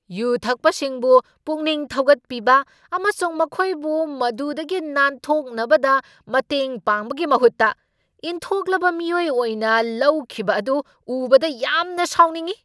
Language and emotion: Manipuri, angry